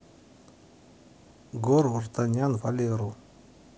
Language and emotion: Russian, neutral